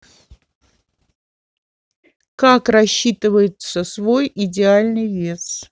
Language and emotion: Russian, neutral